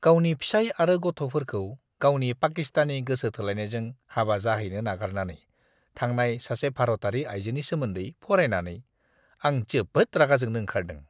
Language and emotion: Bodo, disgusted